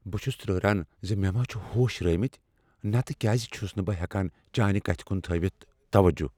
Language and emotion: Kashmiri, fearful